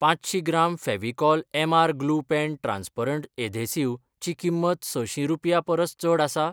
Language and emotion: Goan Konkani, neutral